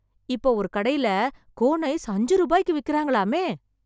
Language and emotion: Tamil, surprised